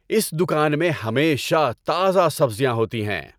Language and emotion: Urdu, happy